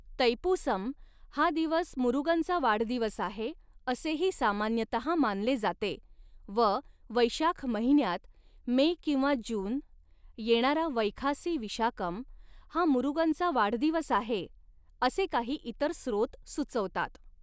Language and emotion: Marathi, neutral